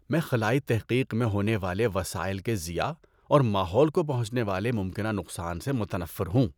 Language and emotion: Urdu, disgusted